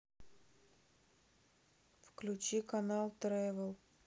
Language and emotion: Russian, sad